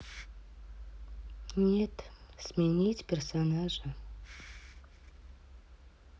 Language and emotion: Russian, sad